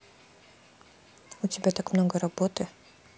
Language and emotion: Russian, neutral